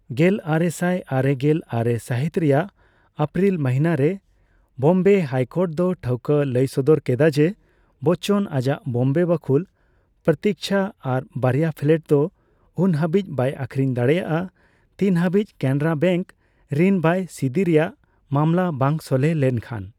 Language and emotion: Santali, neutral